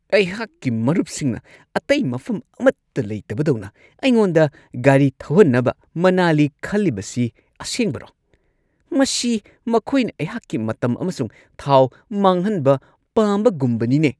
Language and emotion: Manipuri, angry